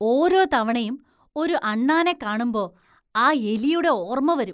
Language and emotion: Malayalam, disgusted